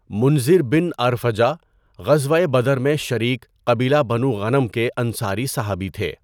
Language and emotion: Urdu, neutral